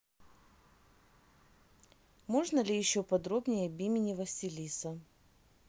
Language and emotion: Russian, neutral